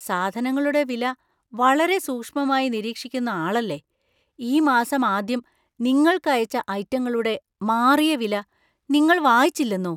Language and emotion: Malayalam, surprised